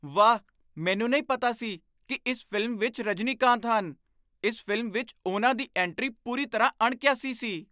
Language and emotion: Punjabi, surprised